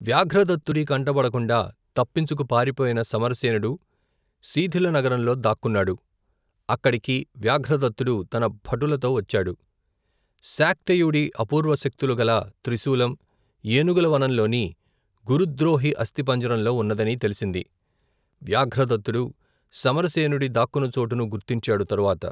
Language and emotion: Telugu, neutral